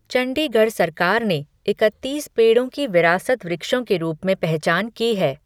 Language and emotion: Hindi, neutral